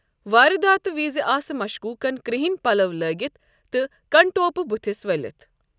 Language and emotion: Kashmiri, neutral